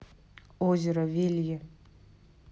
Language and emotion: Russian, neutral